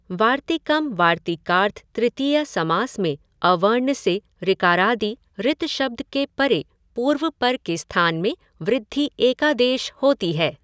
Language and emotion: Hindi, neutral